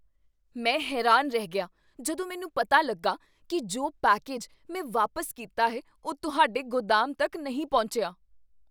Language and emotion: Punjabi, surprised